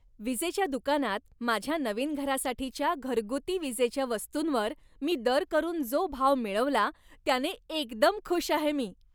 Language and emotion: Marathi, happy